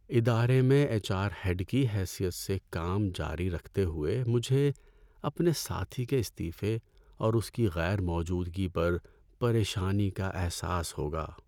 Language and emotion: Urdu, sad